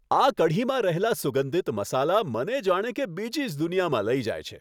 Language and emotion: Gujarati, happy